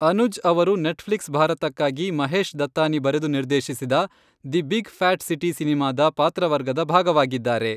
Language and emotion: Kannada, neutral